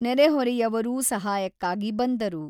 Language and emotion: Kannada, neutral